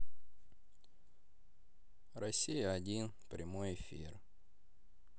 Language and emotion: Russian, sad